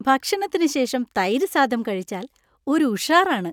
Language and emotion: Malayalam, happy